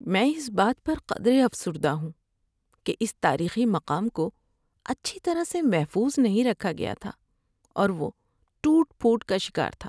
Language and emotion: Urdu, sad